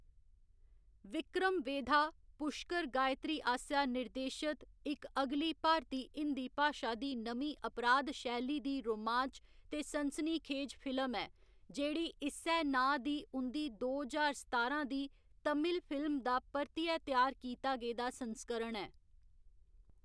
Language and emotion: Dogri, neutral